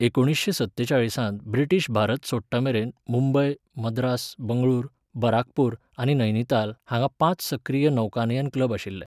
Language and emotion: Goan Konkani, neutral